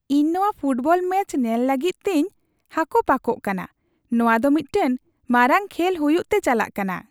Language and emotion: Santali, happy